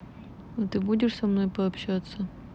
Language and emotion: Russian, neutral